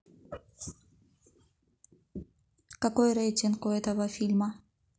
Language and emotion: Russian, neutral